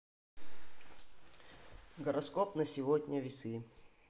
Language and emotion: Russian, neutral